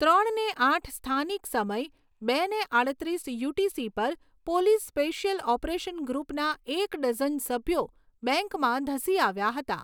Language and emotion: Gujarati, neutral